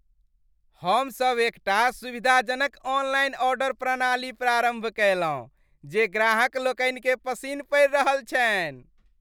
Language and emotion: Maithili, happy